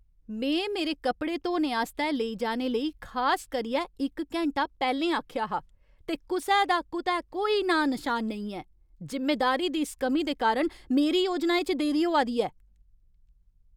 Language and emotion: Dogri, angry